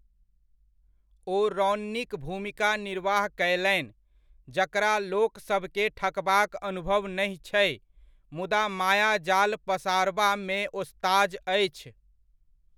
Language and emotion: Maithili, neutral